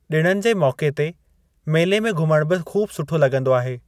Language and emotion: Sindhi, neutral